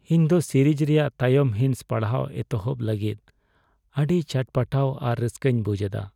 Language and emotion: Santali, sad